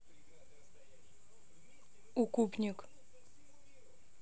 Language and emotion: Russian, neutral